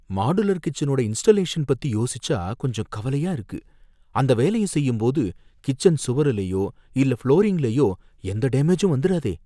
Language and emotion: Tamil, fearful